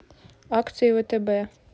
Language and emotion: Russian, neutral